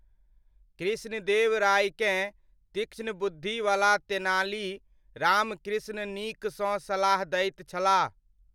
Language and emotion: Maithili, neutral